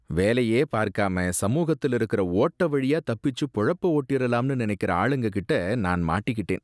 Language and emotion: Tamil, disgusted